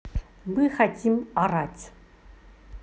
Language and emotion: Russian, neutral